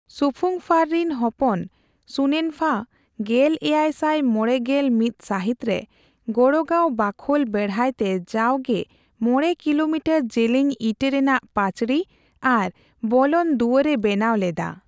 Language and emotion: Santali, neutral